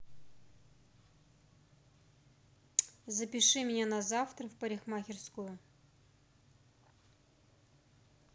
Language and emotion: Russian, neutral